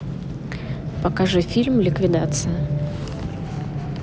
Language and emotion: Russian, neutral